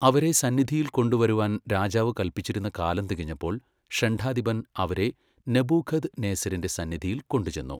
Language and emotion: Malayalam, neutral